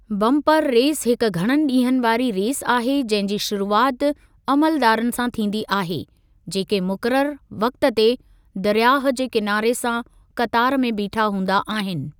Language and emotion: Sindhi, neutral